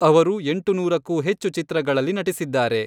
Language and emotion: Kannada, neutral